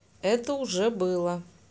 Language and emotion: Russian, neutral